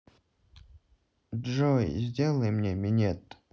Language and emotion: Russian, neutral